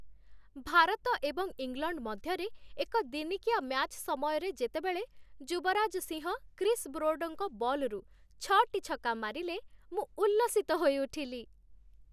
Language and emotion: Odia, happy